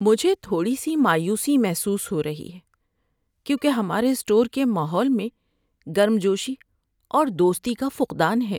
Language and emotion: Urdu, sad